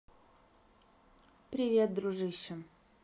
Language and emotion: Russian, neutral